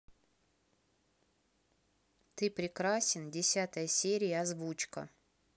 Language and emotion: Russian, neutral